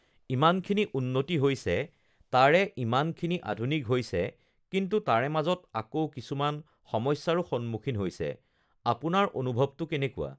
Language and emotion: Assamese, neutral